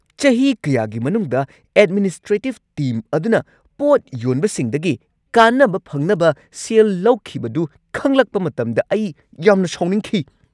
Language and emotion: Manipuri, angry